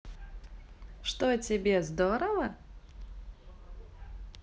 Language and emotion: Russian, positive